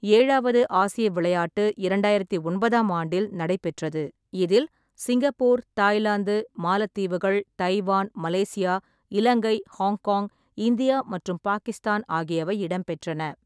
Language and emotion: Tamil, neutral